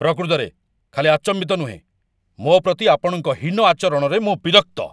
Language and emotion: Odia, angry